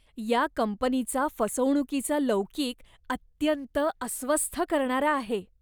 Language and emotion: Marathi, disgusted